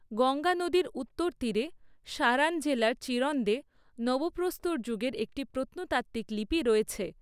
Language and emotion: Bengali, neutral